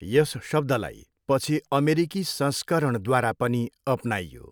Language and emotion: Nepali, neutral